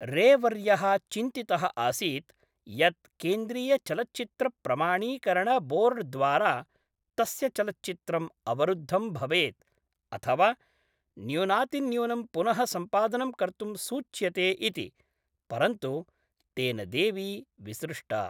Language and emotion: Sanskrit, neutral